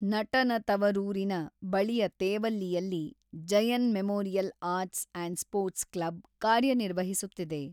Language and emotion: Kannada, neutral